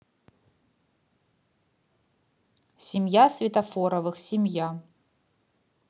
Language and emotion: Russian, neutral